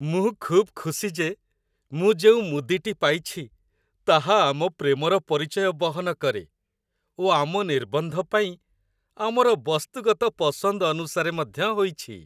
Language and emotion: Odia, happy